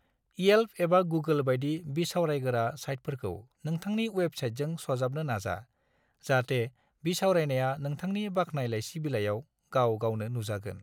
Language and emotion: Bodo, neutral